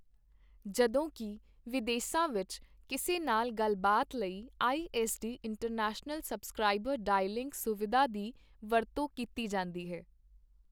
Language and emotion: Punjabi, neutral